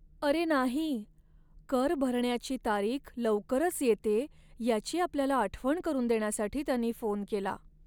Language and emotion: Marathi, sad